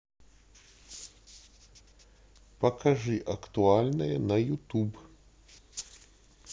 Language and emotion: Russian, neutral